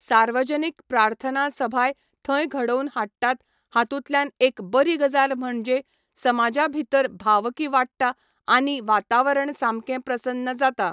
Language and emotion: Goan Konkani, neutral